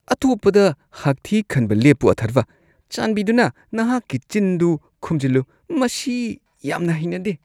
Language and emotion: Manipuri, disgusted